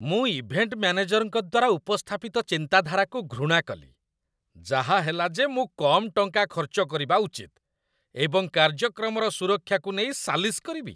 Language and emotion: Odia, disgusted